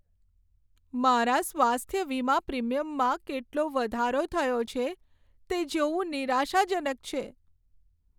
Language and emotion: Gujarati, sad